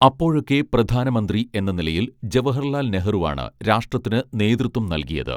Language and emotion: Malayalam, neutral